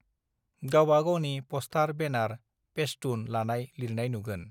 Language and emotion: Bodo, neutral